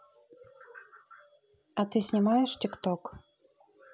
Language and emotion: Russian, neutral